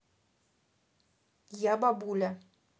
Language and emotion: Russian, neutral